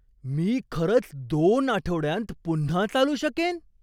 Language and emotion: Marathi, surprised